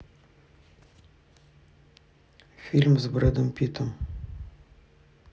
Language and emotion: Russian, neutral